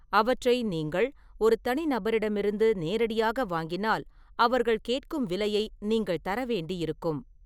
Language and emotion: Tamil, neutral